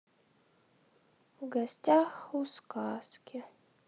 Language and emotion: Russian, sad